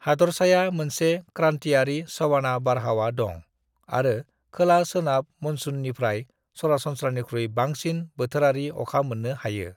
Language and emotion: Bodo, neutral